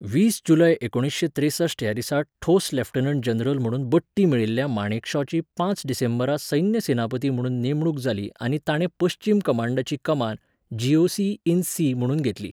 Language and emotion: Goan Konkani, neutral